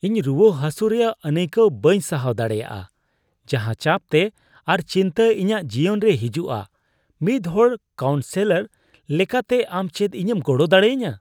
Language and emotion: Santali, disgusted